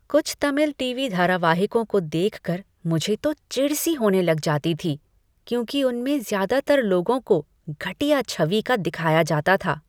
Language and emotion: Hindi, disgusted